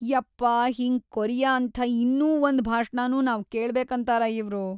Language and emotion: Kannada, disgusted